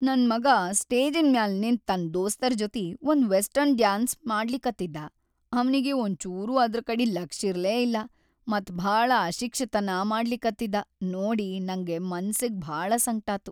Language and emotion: Kannada, sad